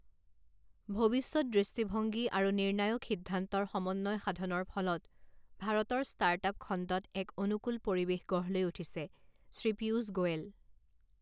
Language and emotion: Assamese, neutral